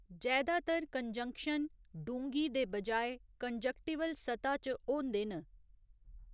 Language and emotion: Dogri, neutral